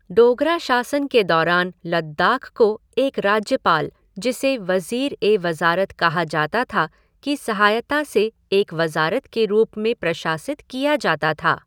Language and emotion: Hindi, neutral